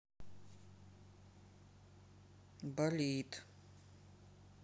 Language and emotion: Russian, sad